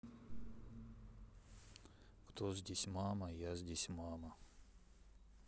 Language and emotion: Russian, sad